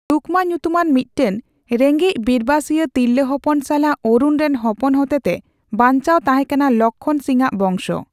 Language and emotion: Santali, neutral